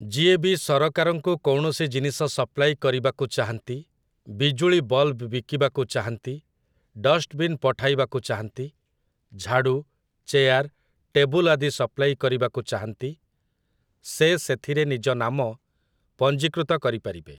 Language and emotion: Odia, neutral